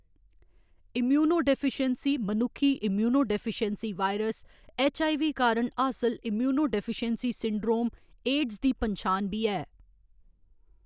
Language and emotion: Dogri, neutral